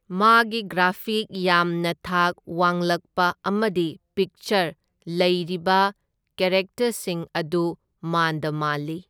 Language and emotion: Manipuri, neutral